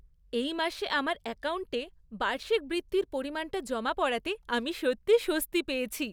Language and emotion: Bengali, happy